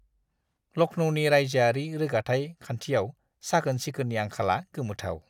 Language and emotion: Bodo, disgusted